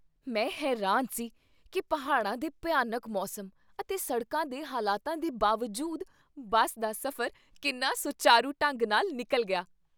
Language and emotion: Punjabi, surprised